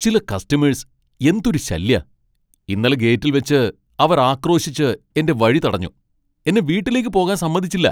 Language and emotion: Malayalam, angry